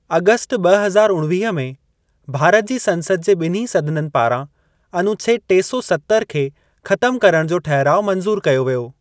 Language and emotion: Sindhi, neutral